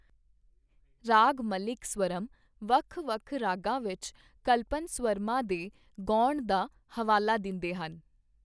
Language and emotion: Punjabi, neutral